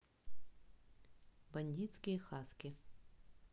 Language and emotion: Russian, neutral